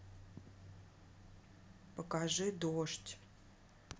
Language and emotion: Russian, neutral